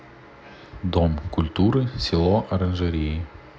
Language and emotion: Russian, neutral